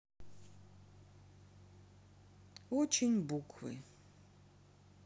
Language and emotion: Russian, sad